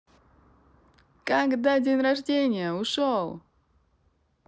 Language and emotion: Russian, positive